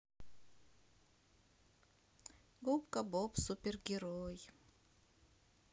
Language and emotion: Russian, sad